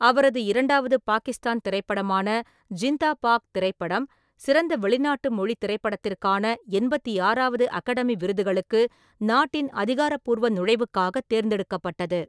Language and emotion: Tamil, neutral